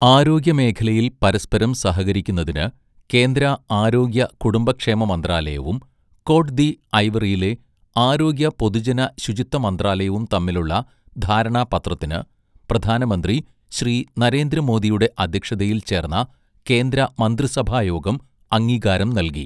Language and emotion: Malayalam, neutral